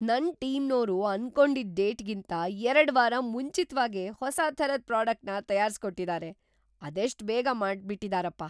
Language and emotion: Kannada, surprised